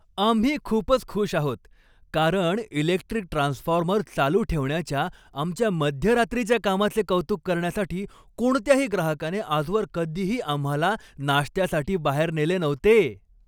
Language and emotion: Marathi, happy